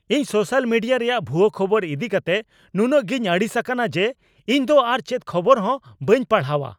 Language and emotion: Santali, angry